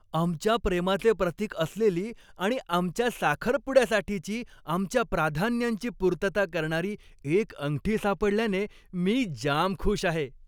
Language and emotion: Marathi, happy